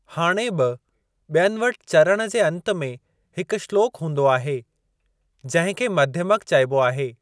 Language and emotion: Sindhi, neutral